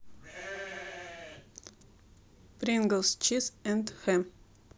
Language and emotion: Russian, neutral